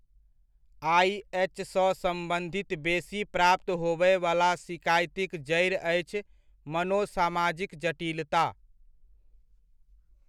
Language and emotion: Maithili, neutral